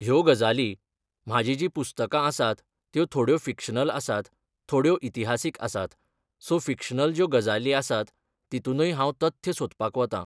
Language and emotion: Goan Konkani, neutral